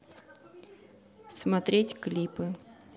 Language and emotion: Russian, neutral